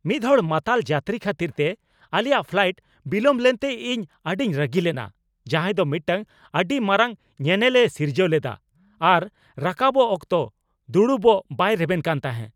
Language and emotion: Santali, angry